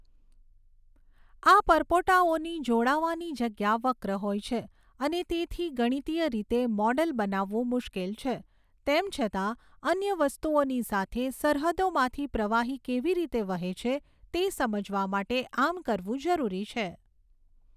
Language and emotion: Gujarati, neutral